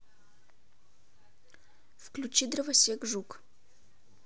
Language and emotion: Russian, neutral